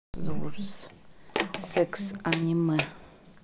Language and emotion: Russian, neutral